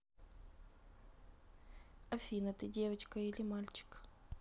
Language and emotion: Russian, neutral